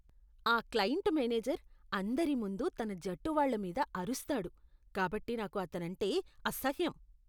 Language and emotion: Telugu, disgusted